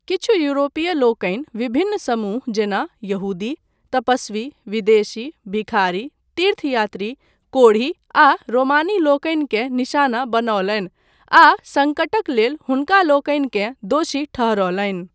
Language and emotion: Maithili, neutral